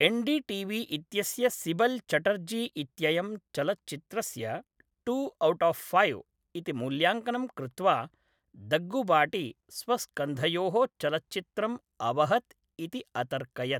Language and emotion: Sanskrit, neutral